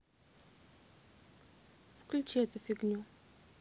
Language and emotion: Russian, neutral